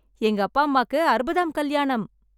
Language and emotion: Tamil, happy